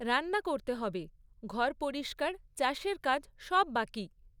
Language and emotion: Bengali, neutral